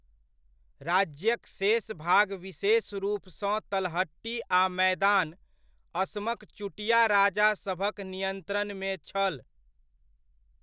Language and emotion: Maithili, neutral